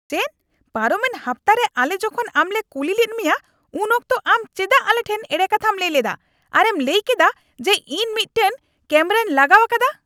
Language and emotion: Santali, angry